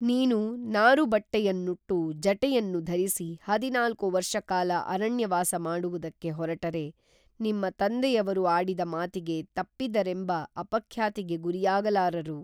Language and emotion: Kannada, neutral